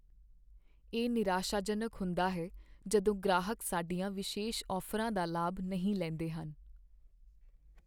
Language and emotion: Punjabi, sad